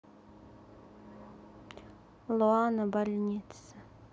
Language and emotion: Russian, sad